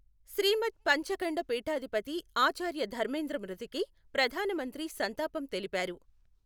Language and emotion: Telugu, neutral